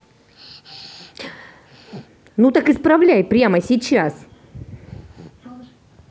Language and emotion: Russian, angry